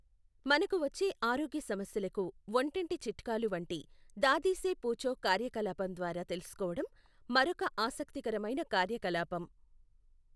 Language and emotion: Telugu, neutral